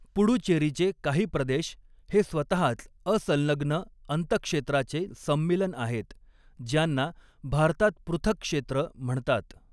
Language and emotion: Marathi, neutral